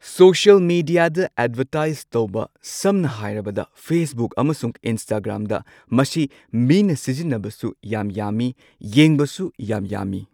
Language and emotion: Manipuri, neutral